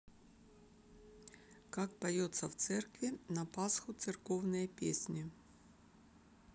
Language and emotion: Russian, neutral